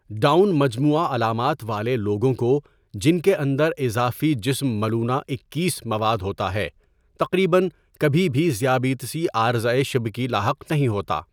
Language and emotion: Urdu, neutral